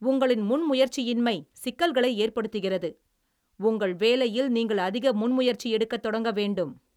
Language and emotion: Tamil, angry